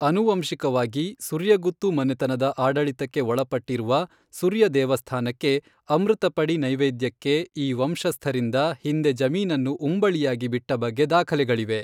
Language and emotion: Kannada, neutral